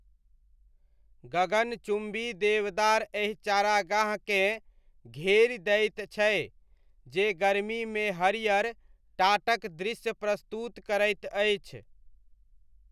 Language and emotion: Maithili, neutral